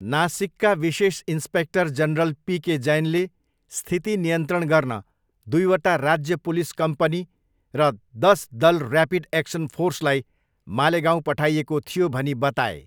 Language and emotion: Nepali, neutral